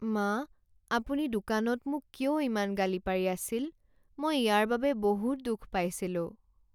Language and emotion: Assamese, sad